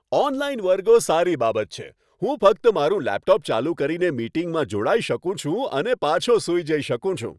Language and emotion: Gujarati, happy